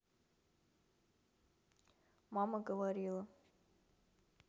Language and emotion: Russian, neutral